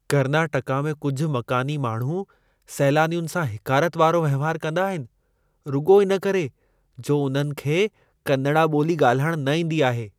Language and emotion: Sindhi, disgusted